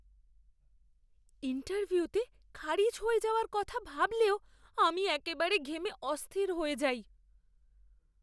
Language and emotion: Bengali, fearful